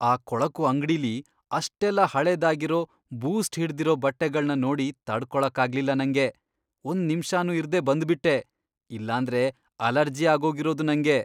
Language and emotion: Kannada, disgusted